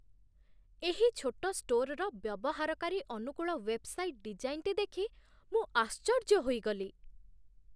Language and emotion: Odia, surprised